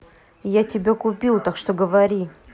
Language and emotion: Russian, angry